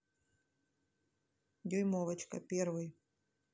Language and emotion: Russian, neutral